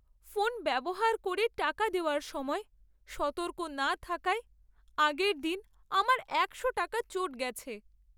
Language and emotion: Bengali, sad